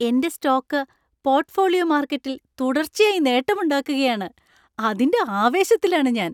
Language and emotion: Malayalam, happy